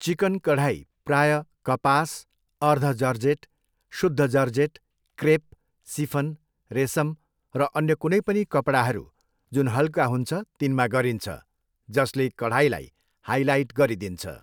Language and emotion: Nepali, neutral